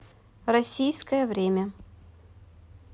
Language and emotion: Russian, neutral